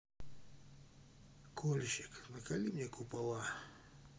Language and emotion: Russian, sad